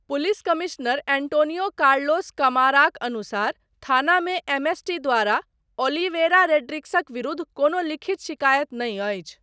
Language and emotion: Maithili, neutral